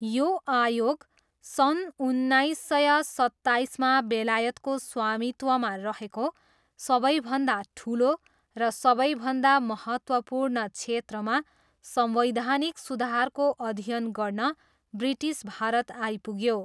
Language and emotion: Nepali, neutral